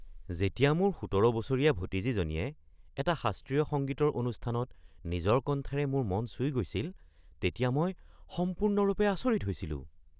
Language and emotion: Assamese, surprised